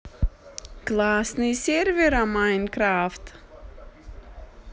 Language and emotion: Russian, positive